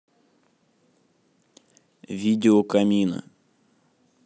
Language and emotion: Russian, neutral